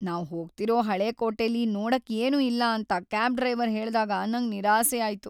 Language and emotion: Kannada, sad